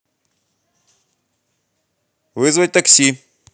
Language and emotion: Russian, neutral